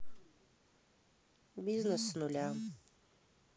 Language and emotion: Russian, neutral